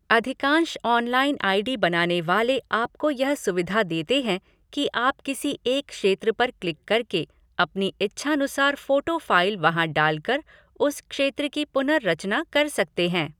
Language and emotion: Hindi, neutral